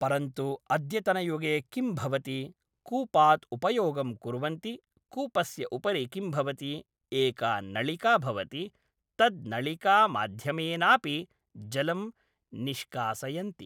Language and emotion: Sanskrit, neutral